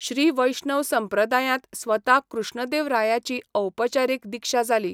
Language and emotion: Goan Konkani, neutral